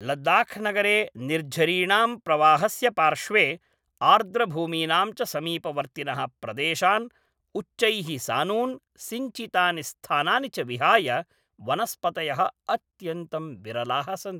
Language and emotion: Sanskrit, neutral